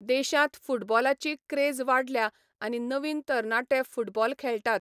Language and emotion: Goan Konkani, neutral